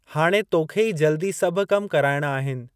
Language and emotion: Sindhi, neutral